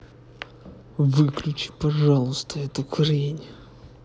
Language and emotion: Russian, angry